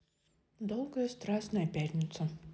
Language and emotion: Russian, neutral